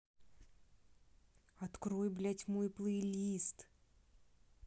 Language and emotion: Russian, angry